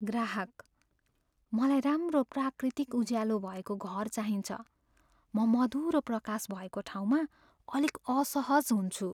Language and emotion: Nepali, fearful